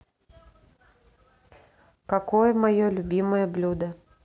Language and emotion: Russian, neutral